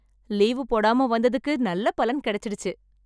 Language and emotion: Tamil, happy